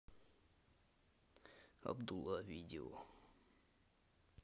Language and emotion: Russian, neutral